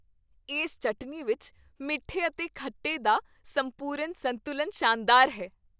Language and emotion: Punjabi, happy